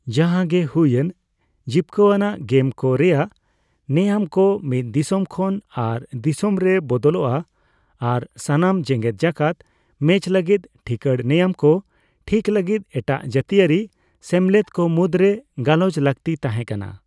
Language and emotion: Santali, neutral